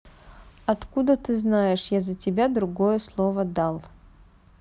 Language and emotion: Russian, neutral